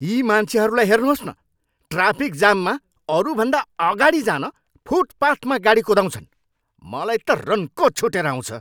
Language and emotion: Nepali, angry